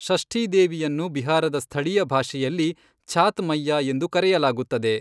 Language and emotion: Kannada, neutral